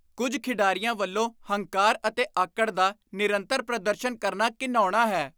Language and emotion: Punjabi, disgusted